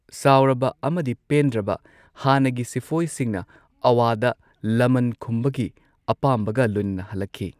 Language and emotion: Manipuri, neutral